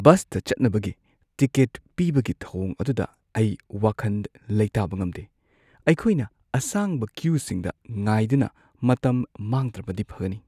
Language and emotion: Manipuri, fearful